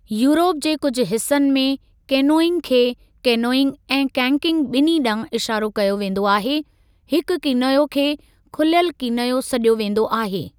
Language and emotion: Sindhi, neutral